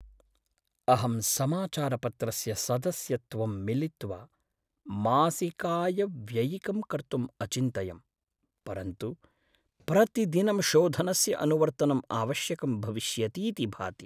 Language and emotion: Sanskrit, sad